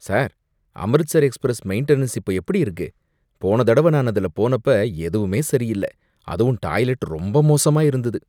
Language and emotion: Tamil, disgusted